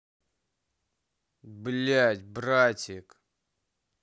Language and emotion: Russian, angry